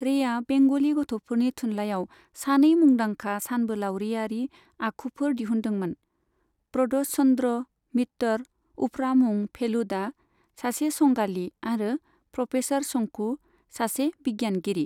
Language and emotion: Bodo, neutral